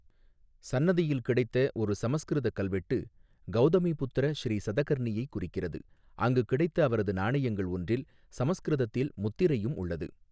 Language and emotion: Tamil, neutral